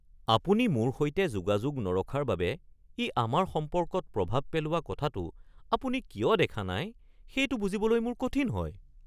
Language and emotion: Assamese, surprised